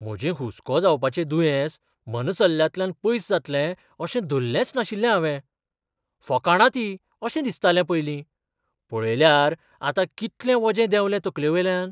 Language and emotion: Goan Konkani, surprised